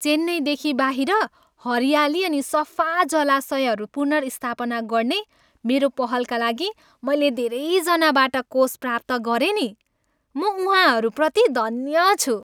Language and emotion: Nepali, happy